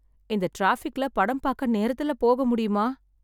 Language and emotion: Tamil, sad